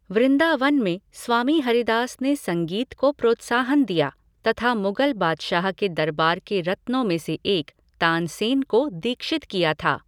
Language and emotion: Hindi, neutral